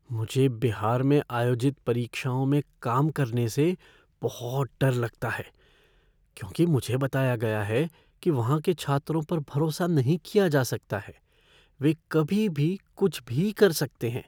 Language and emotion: Hindi, fearful